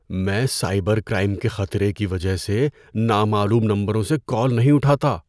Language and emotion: Urdu, fearful